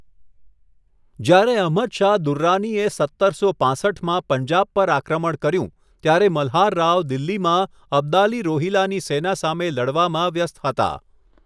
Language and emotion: Gujarati, neutral